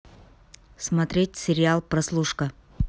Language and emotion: Russian, neutral